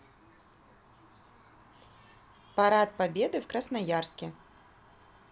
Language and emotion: Russian, neutral